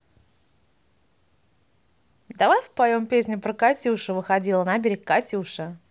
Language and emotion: Russian, positive